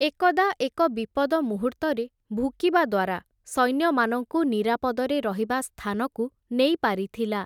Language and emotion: Odia, neutral